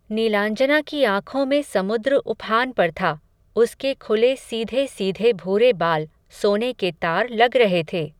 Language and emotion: Hindi, neutral